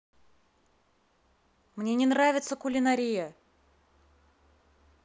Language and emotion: Russian, angry